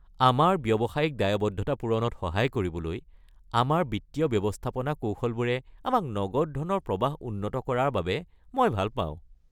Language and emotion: Assamese, happy